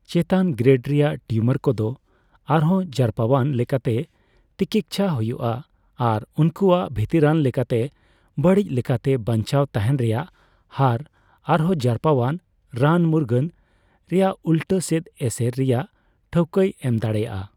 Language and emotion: Santali, neutral